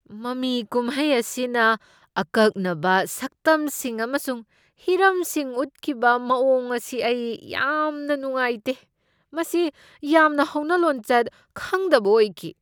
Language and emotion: Manipuri, disgusted